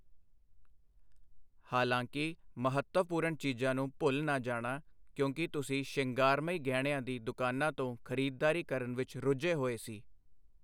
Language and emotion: Punjabi, neutral